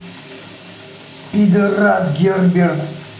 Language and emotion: Russian, angry